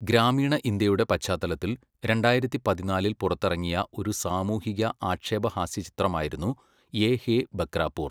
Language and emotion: Malayalam, neutral